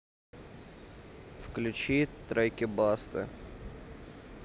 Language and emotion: Russian, neutral